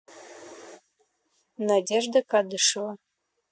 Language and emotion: Russian, neutral